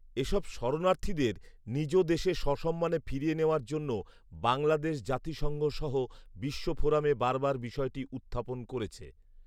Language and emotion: Bengali, neutral